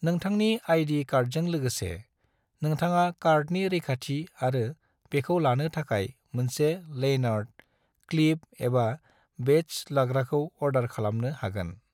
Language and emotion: Bodo, neutral